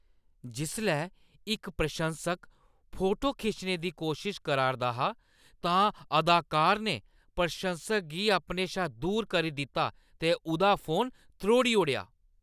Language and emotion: Dogri, angry